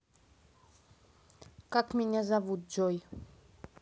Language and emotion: Russian, neutral